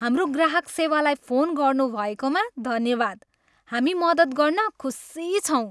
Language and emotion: Nepali, happy